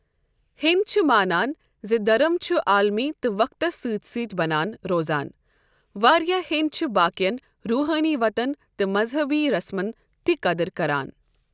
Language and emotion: Kashmiri, neutral